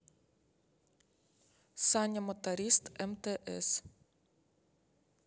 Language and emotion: Russian, neutral